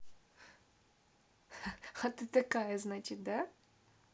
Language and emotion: Russian, positive